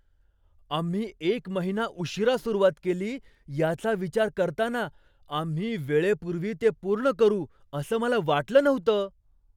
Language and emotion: Marathi, surprised